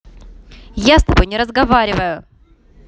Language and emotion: Russian, angry